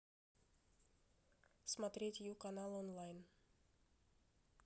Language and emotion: Russian, neutral